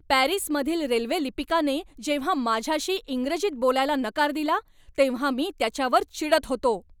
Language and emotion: Marathi, angry